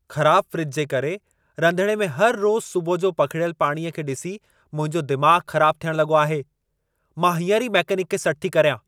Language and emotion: Sindhi, angry